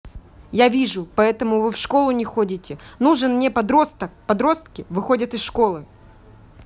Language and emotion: Russian, angry